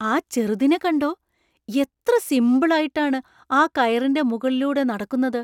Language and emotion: Malayalam, surprised